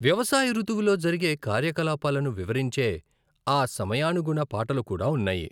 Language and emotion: Telugu, neutral